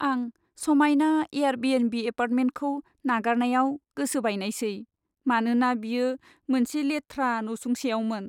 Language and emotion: Bodo, sad